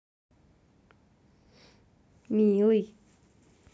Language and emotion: Russian, positive